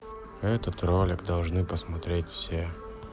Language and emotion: Russian, sad